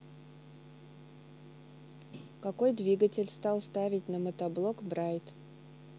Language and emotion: Russian, neutral